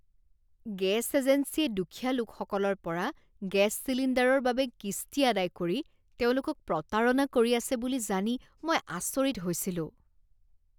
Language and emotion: Assamese, disgusted